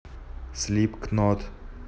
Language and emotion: Russian, neutral